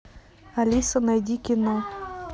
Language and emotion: Russian, neutral